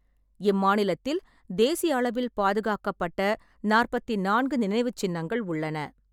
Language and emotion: Tamil, neutral